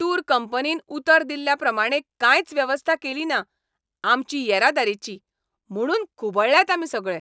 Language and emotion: Goan Konkani, angry